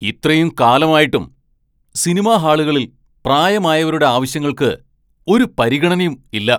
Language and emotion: Malayalam, angry